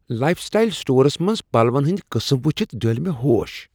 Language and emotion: Kashmiri, surprised